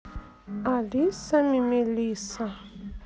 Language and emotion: Russian, neutral